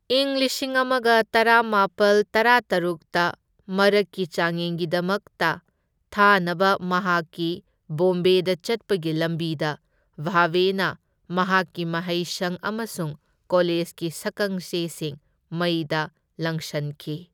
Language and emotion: Manipuri, neutral